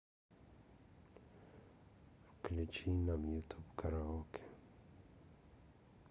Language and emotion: Russian, neutral